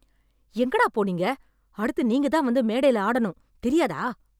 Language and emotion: Tamil, angry